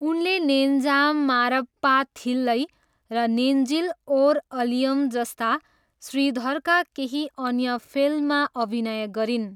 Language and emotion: Nepali, neutral